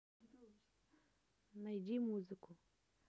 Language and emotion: Russian, neutral